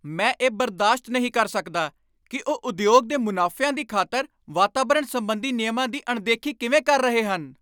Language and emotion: Punjabi, angry